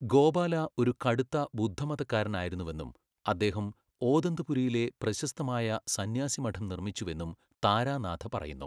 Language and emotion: Malayalam, neutral